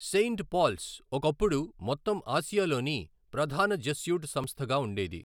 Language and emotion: Telugu, neutral